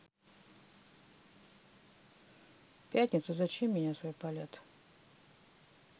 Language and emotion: Russian, neutral